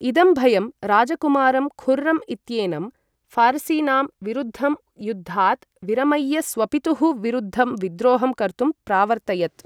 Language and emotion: Sanskrit, neutral